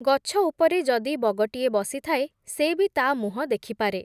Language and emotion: Odia, neutral